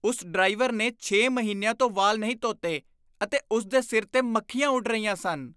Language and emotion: Punjabi, disgusted